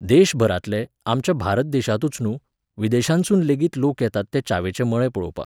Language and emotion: Goan Konkani, neutral